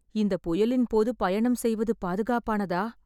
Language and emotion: Tamil, fearful